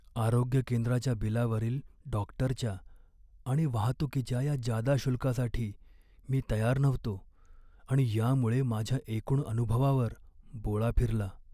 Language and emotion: Marathi, sad